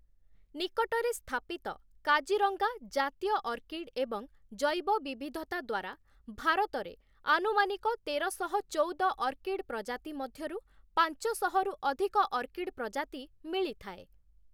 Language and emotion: Odia, neutral